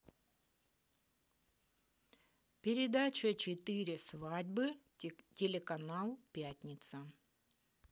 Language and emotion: Russian, neutral